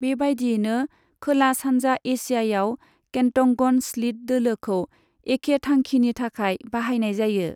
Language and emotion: Bodo, neutral